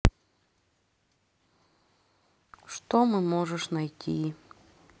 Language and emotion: Russian, sad